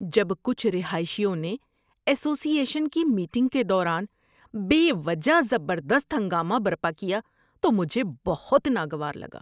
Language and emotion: Urdu, disgusted